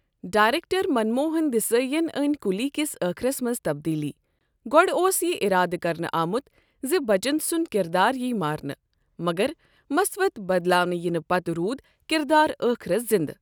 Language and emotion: Kashmiri, neutral